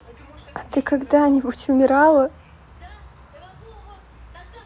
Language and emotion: Russian, sad